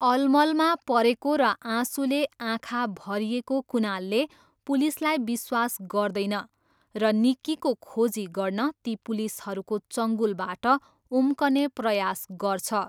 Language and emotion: Nepali, neutral